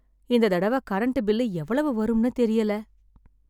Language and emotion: Tamil, sad